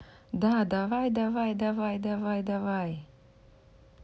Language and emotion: Russian, neutral